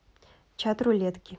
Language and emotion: Russian, neutral